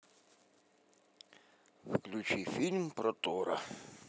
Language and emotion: Russian, neutral